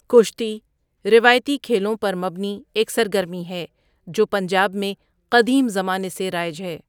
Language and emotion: Urdu, neutral